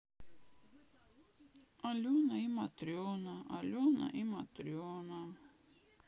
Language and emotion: Russian, sad